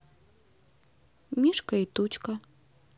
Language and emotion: Russian, neutral